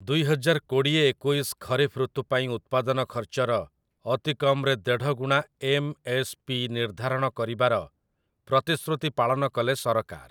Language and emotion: Odia, neutral